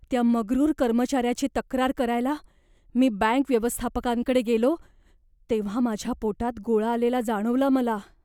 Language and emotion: Marathi, fearful